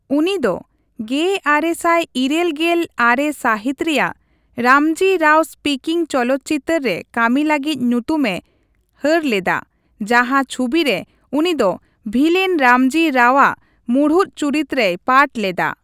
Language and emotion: Santali, neutral